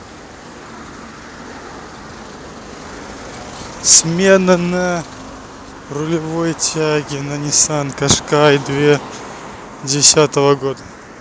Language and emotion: Russian, neutral